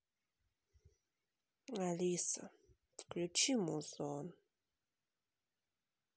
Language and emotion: Russian, sad